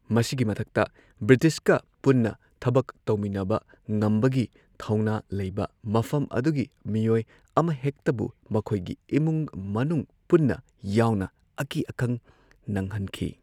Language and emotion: Manipuri, neutral